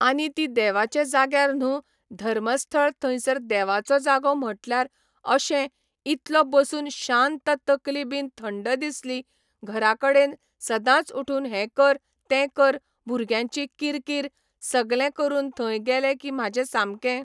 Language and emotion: Goan Konkani, neutral